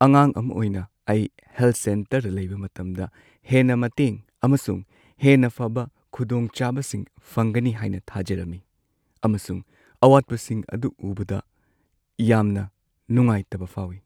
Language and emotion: Manipuri, sad